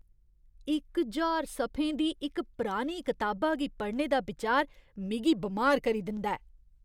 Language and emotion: Dogri, disgusted